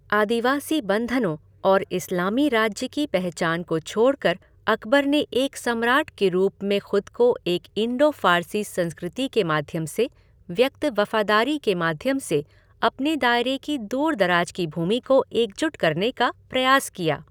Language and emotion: Hindi, neutral